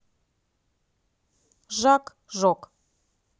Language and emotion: Russian, neutral